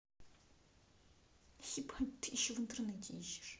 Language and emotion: Russian, angry